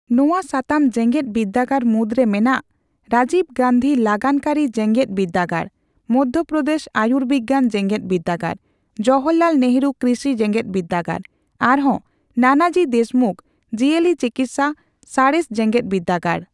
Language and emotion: Santali, neutral